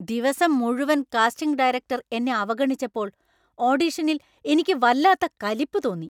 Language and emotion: Malayalam, angry